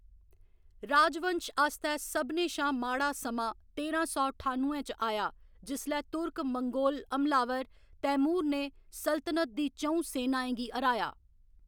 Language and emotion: Dogri, neutral